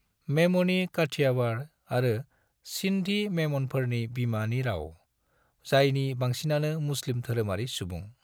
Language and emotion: Bodo, neutral